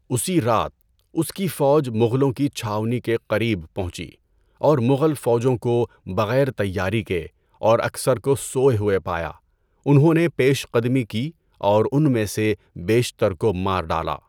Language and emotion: Urdu, neutral